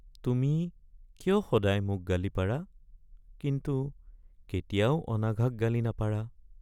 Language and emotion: Assamese, sad